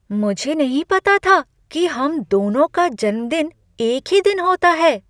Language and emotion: Hindi, surprised